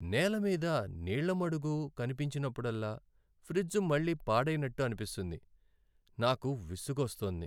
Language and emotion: Telugu, sad